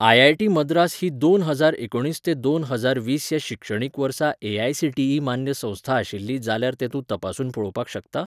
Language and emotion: Goan Konkani, neutral